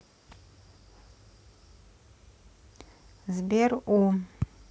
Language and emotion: Russian, neutral